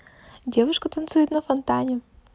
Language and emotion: Russian, positive